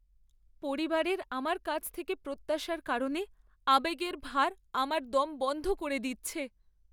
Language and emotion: Bengali, sad